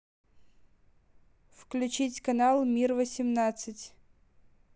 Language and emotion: Russian, neutral